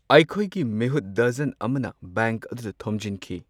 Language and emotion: Manipuri, neutral